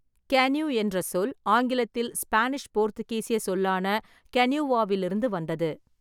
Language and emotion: Tamil, neutral